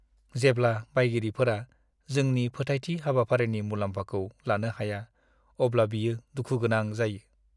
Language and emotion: Bodo, sad